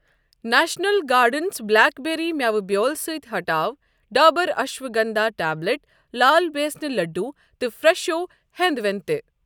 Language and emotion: Kashmiri, neutral